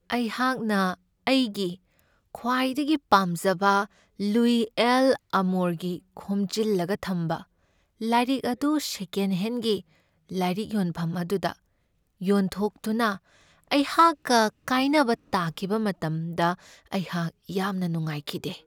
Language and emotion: Manipuri, sad